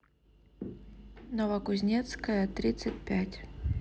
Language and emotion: Russian, neutral